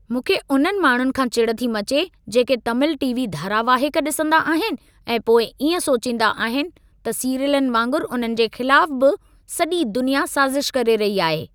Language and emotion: Sindhi, angry